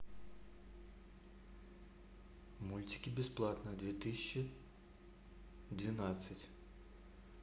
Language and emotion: Russian, neutral